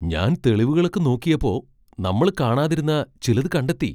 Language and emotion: Malayalam, surprised